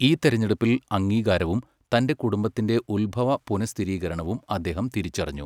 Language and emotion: Malayalam, neutral